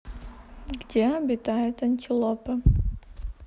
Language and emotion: Russian, neutral